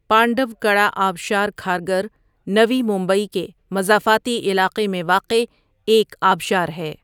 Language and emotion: Urdu, neutral